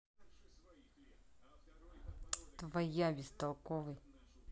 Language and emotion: Russian, angry